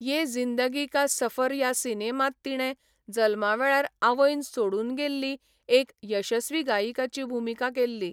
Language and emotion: Goan Konkani, neutral